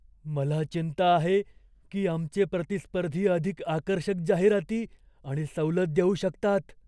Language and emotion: Marathi, fearful